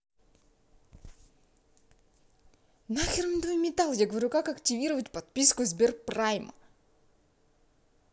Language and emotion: Russian, angry